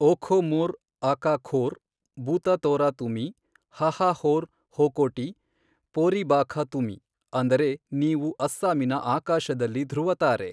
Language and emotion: Kannada, neutral